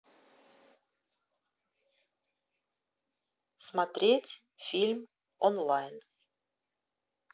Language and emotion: Russian, neutral